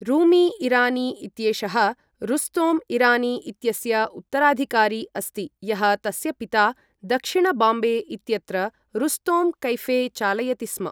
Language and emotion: Sanskrit, neutral